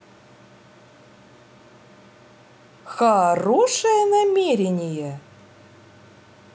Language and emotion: Russian, positive